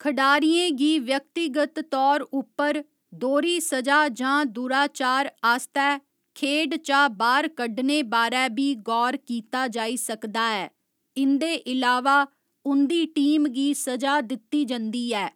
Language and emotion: Dogri, neutral